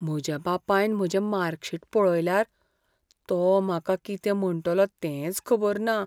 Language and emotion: Goan Konkani, fearful